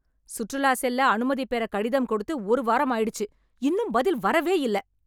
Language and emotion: Tamil, angry